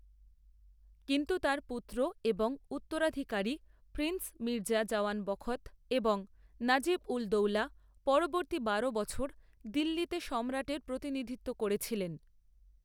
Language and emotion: Bengali, neutral